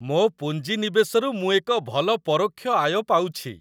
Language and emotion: Odia, happy